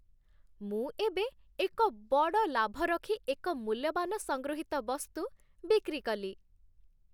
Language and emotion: Odia, happy